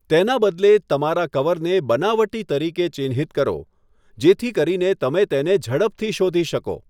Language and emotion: Gujarati, neutral